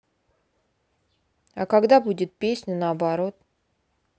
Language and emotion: Russian, neutral